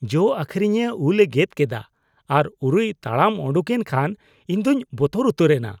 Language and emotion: Santali, disgusted